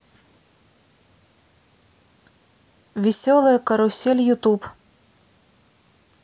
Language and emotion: Russian, neutral